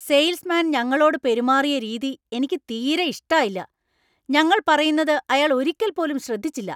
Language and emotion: Malayalam, angry